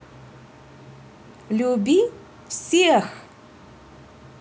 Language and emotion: Russian, positive